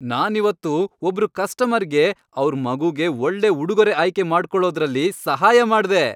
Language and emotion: Kannada, happy